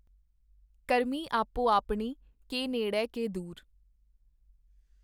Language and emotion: Punjabi, neutral